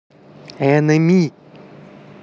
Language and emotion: Russian, neutral